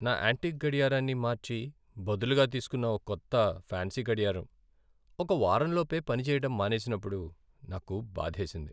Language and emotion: Telugu, sad